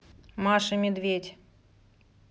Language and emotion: Russian, neutral